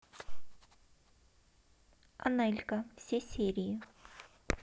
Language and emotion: Russian, neutral